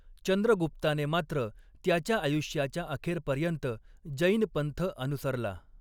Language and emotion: Marathi, neutral